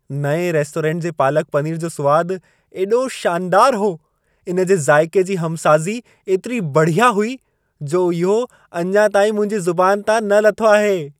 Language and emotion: Sindhi, happy